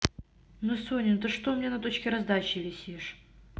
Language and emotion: Russian, neutral